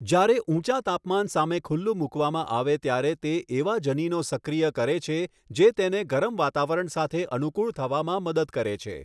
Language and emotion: Gujarati, neutral